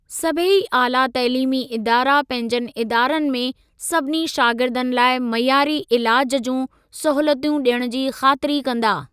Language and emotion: Sindhi, neutral